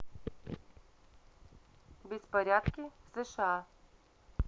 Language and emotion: Russian, neutral